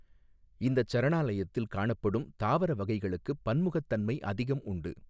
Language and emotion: Tamil, neutral